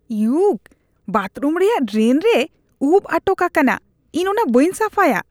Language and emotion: Santali, disgusted